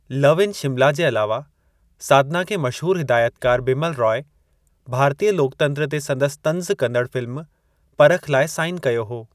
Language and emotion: Sindhi, neutral